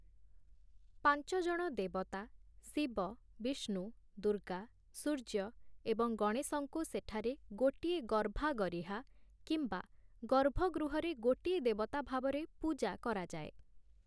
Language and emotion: Odia, neutral